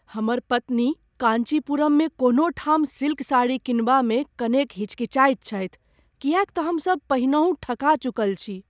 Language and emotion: Maithili, fearful